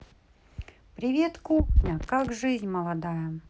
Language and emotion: Russian, positive